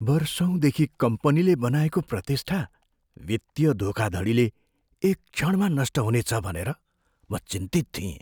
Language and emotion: Nepali, fearful